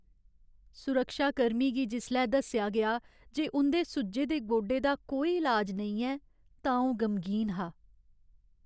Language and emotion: Dogri, sad